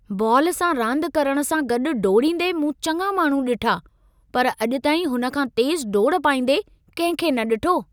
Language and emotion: Sindhi, surprised